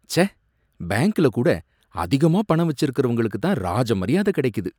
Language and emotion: Tamil, disgusted